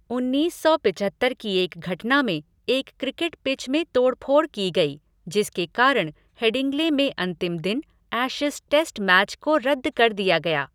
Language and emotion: Hindi, neutral